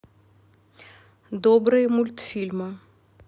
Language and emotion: Russian, neutral